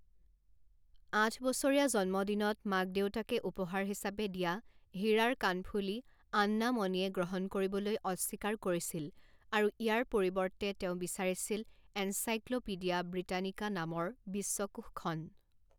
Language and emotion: Assamese, neutral